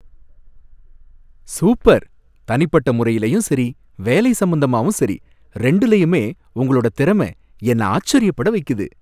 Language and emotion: Tamil, happy